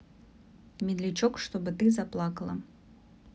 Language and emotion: Russian, neutral